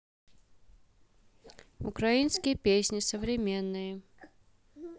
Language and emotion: Russian, neutral